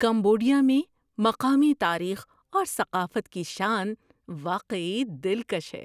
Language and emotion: Urdu, surprised